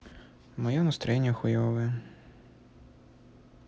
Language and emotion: Russian, sad